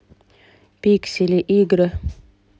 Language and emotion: Russian, neutral